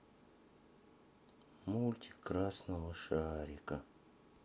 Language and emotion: Russian, sad